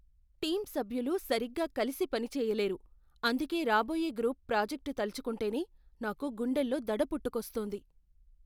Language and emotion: Telugu, fearful